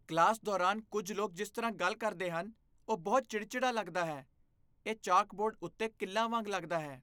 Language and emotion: Punjabi, disgusted